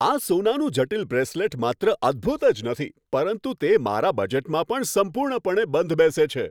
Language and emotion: Gujarati, happy